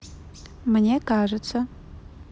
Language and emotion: Russian, neutral